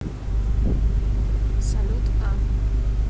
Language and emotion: Russian, neutral